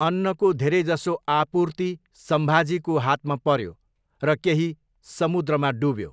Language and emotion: Nepali, neutral